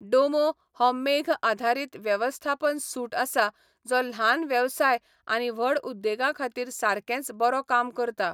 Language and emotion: Goan Konkani, neutral